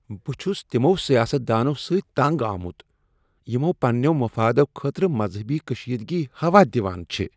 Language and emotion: Kashmiri, disgusted